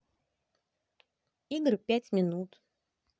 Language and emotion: Russian, neutral